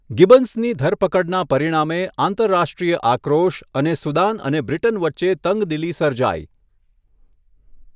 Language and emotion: Gujarati, neutral